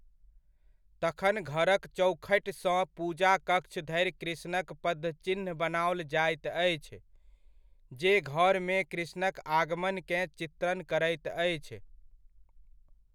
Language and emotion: Maithili, neutral